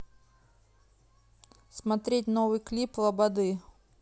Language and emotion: Russian, neutral